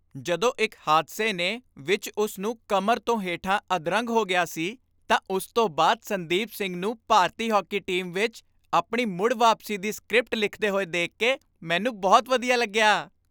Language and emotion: Punjabi, happy